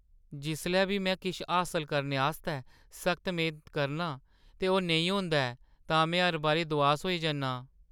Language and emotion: Dogri, sad